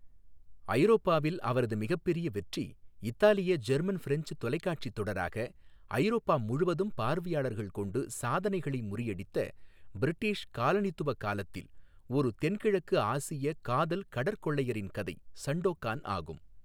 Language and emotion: Tamil, neutral